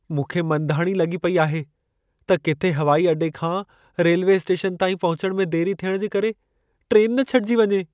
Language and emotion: Sindhi, fearful